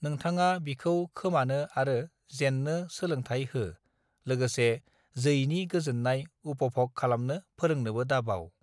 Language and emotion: Bodo, neutral